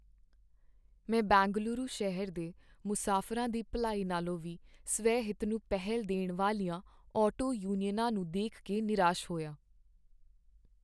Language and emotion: Punjabi, sad